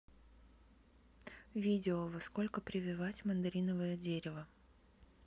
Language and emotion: Russian, neutral